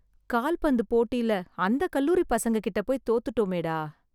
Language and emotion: Tamil, sad